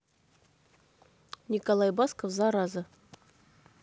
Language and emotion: Russian, neutral